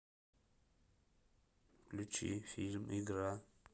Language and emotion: Russian, neutral